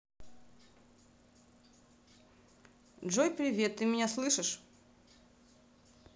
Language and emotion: Russian, neutral